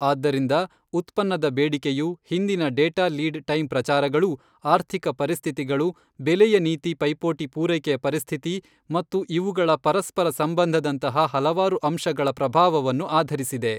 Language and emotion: Kannada, neutral